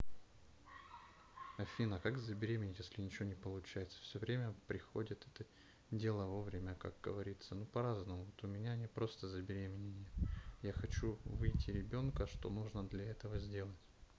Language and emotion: Russian, neutral